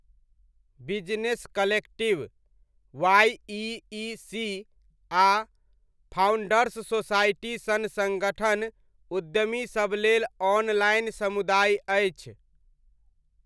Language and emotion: Maithili, neutral